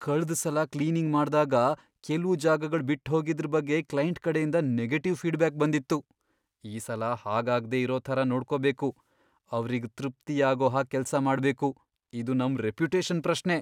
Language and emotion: Kannada, fearful